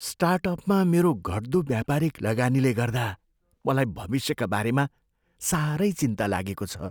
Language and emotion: Nepali, fearful